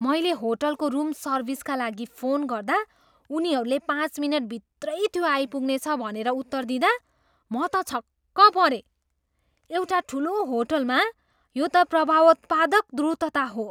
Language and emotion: Nepali, surprised